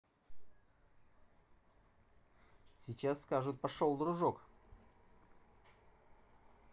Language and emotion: Russian, neutral